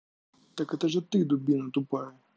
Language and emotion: Russian, angry